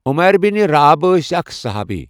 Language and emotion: Kashmiri, neutral